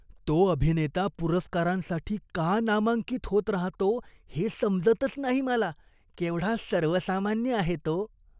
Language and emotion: Marathi, disgusted